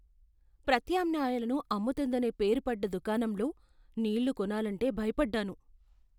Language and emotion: Telugu, fearful